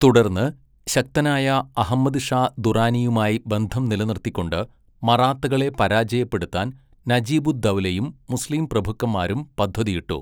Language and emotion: Malayalam, neutral